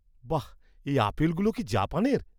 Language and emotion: Bengali, surprised